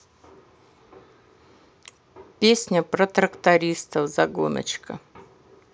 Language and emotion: Russian, neutral